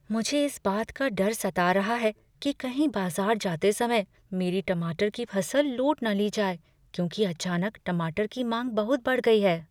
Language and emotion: Hindi, fearful